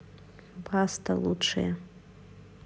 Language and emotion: Russian, neutral